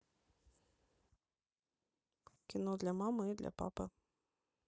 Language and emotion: Russian, neutral